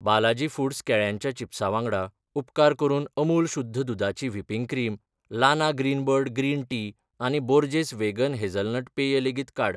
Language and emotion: Goan Konkani, neutral